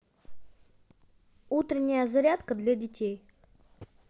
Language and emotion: Russian, positive